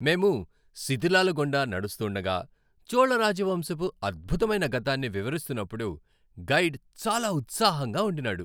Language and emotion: Telugu, happy